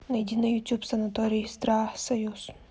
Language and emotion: Russian, neutral